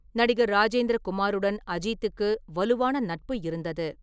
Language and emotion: Tamil, neutral